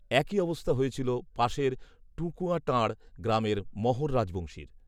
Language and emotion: Bengali, neutral